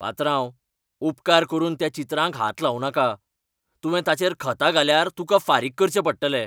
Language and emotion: Goan Konkani, angry